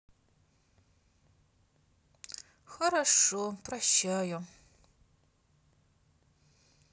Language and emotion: Russian, sad